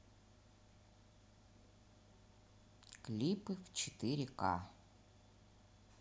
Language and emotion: Russian, neutral